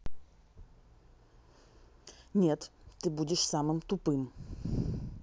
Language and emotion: Russian, angry